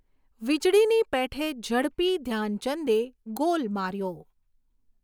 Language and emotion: Gujarati, neutral